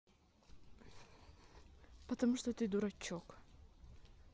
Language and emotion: Russian, neutral